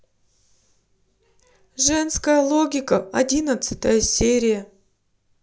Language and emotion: Russian, sad